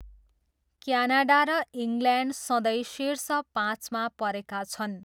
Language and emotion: Nepali, neutral